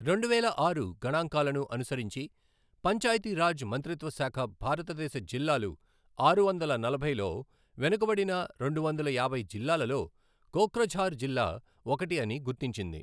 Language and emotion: Telugu, neutral